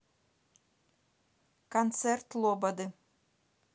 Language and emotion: Russian, neutral